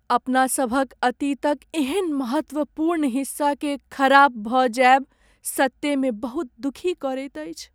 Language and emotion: Maithili, sad